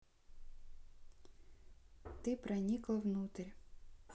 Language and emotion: Russian, neutral